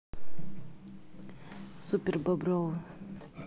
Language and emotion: Russian, neutral